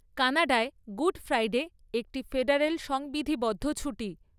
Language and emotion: Bengali, neutral